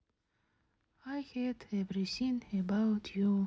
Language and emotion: Russian, sad